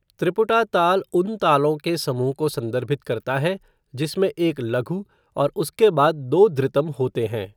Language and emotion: Hindi, neutral